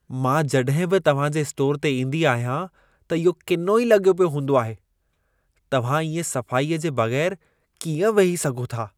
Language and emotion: Sindhi, disgusted